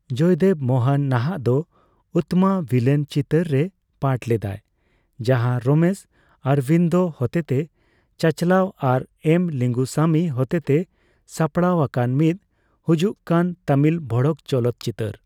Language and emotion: Santali, neutral